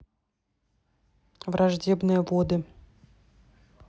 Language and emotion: Russian, neutral